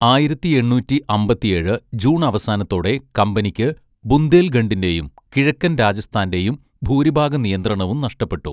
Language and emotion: Malayalam, neutral